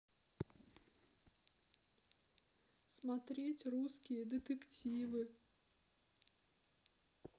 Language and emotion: Russian, sad